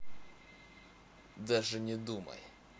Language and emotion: Russian, angry